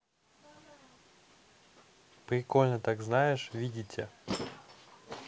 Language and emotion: Russian, neutral